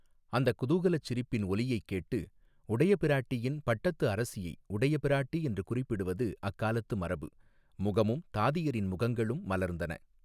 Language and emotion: Tamil, neutral